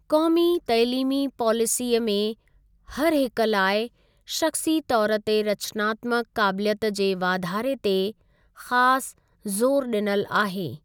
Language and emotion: Sindhi, neutral